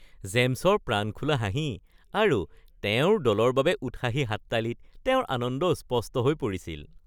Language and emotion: Assamese, happy